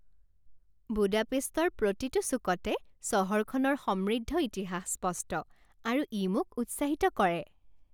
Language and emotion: Assamese, happy